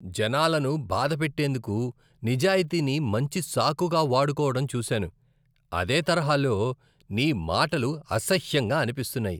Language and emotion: Telugu, disgusted